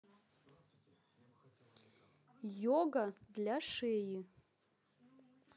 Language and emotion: Russian, neutral